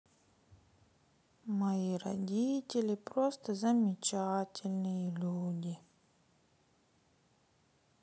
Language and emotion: Russian, sad